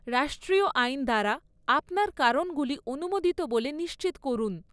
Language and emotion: Bengali, neutral